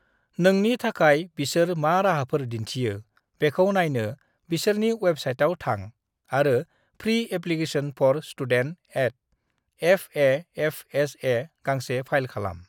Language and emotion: Bodo, neutral